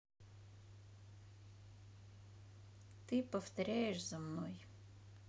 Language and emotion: Russian, neutral